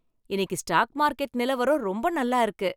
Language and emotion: Tamil, happy